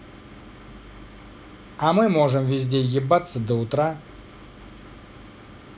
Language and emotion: Russian, positive